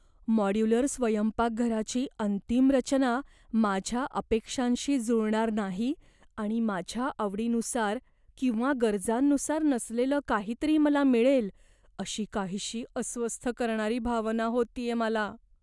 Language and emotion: Marathi, fearful